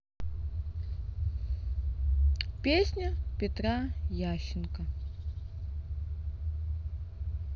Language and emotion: Russian, neutral